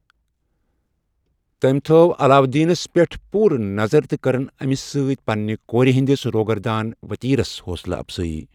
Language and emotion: Kashmiri, neutral